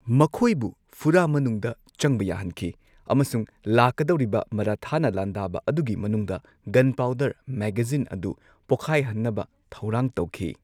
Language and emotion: Manipuri, neutral